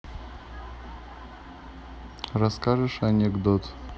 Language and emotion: Russian, neutral